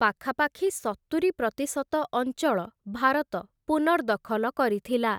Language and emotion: Odia, neutral